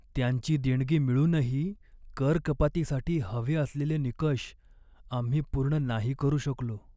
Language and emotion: Marathi, sad